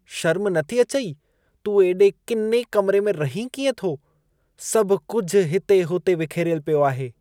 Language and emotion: Sindhi, disgusted